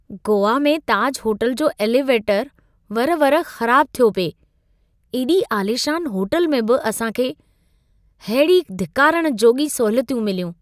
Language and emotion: Sindhi, disgusted